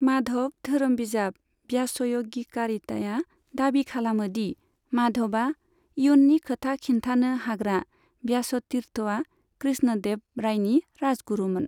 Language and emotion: Bodo, neutral